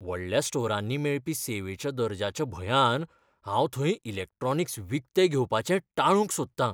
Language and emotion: Goan Konkani, fearful